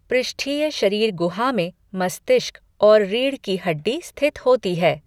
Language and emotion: Hindi, neutral